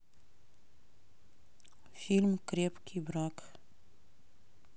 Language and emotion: Russian, neutral